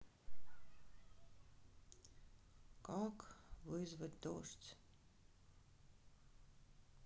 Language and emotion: Russian, sad